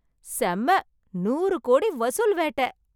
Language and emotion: Tamil, happy